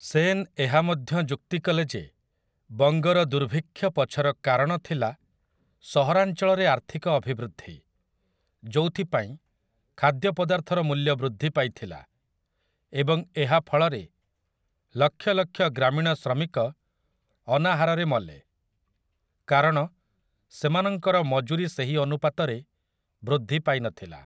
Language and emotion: Odia, neutral